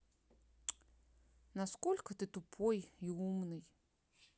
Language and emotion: Russian, angry